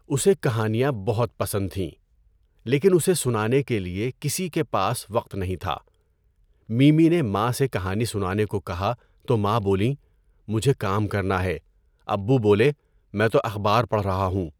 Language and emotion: Urdu, neutral